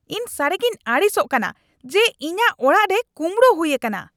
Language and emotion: Santali, angry